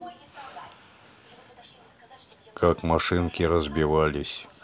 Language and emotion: Russian, neutral